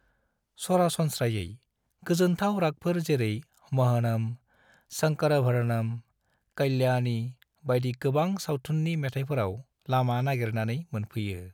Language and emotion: Bodo, neutral